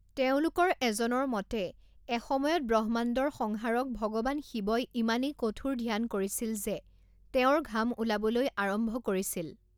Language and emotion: Assamese, neutral